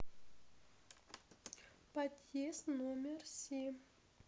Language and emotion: Russian, neutral